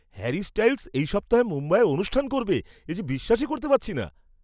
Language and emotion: Bengali, surprised